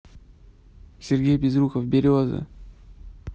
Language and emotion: Russian, neutral